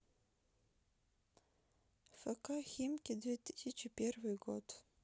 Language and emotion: Russian, sad